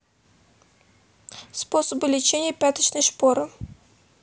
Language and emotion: Russian, neutral